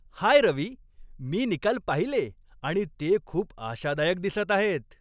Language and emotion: Marathi, happy